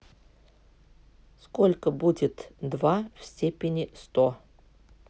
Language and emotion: Russian, neutral